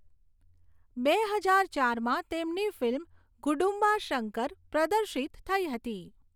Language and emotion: Gujarati, neutral